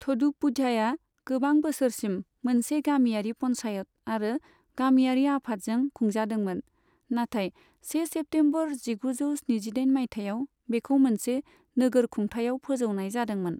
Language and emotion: Bodo, neutral